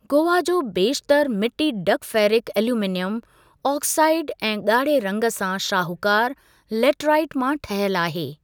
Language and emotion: Sindhi, neutral